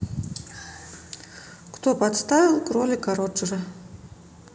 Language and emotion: Russian, neutral